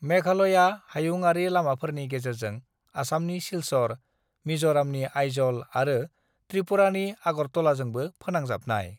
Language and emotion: Bodo, neutral